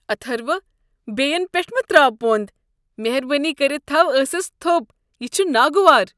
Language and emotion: Kashmiri, disgusted